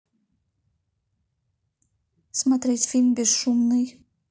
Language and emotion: Russian, neutral